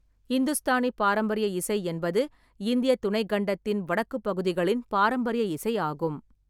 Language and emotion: Tamil, neutral